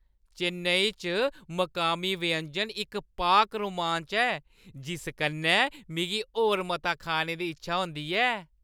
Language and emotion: Dogri, happy